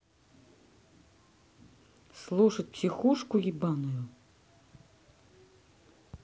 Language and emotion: Russian, neutral